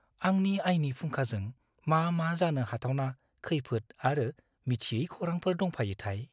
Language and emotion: Bodo, fearful